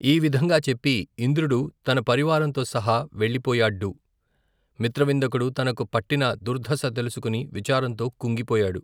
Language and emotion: Telugu, neutral